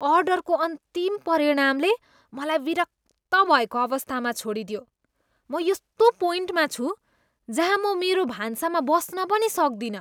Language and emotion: Nepali, disgusted